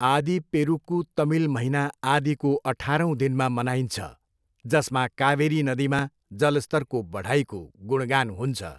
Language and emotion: Nepali, neutral